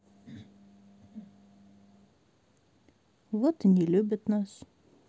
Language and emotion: Russian, sad